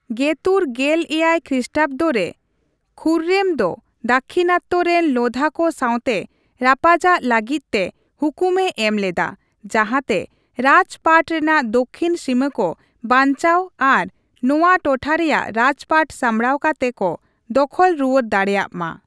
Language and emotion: Santali, neutral